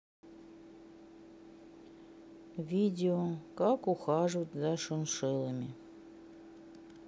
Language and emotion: Russian, sad